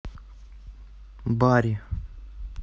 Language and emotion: Russian, neutral